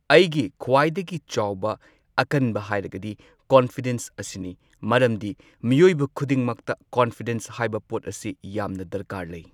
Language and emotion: Manipuri, neutral